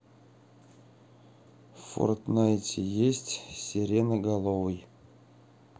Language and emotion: Russian, sad